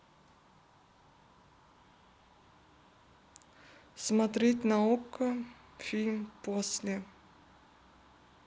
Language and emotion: Russian, neutral